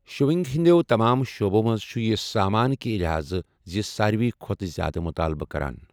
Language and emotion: Kashmiri, neutral